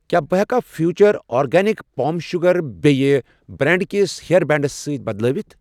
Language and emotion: Kashmiri, neutral